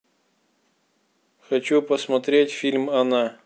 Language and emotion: Russian, neutral